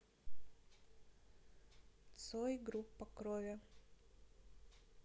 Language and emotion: Russian, neutral